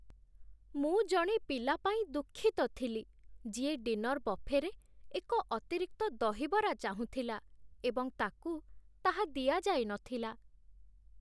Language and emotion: Odia, sad